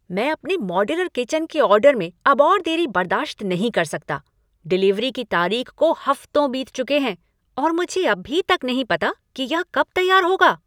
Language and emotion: Hindi, angry